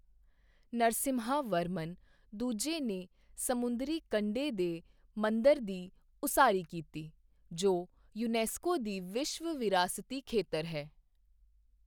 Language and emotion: Punjabi, neutral